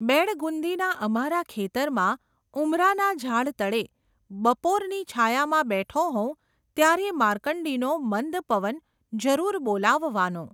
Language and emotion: Gujarati, neutral